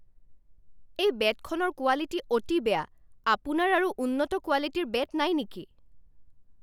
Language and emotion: Assamese, angry